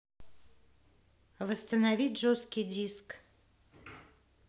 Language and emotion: Russian, neutral